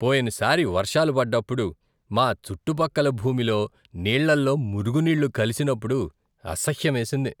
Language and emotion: Telugu, disgusted